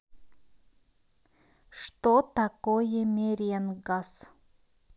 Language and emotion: Russian, neutral